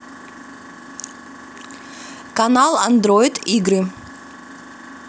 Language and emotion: Russian, positive